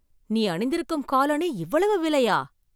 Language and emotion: Tamil, surprised